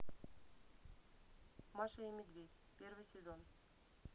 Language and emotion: Russian, neutral